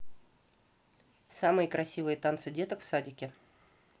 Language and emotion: Russian, neutral